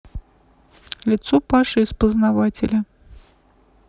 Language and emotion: Russian, neutral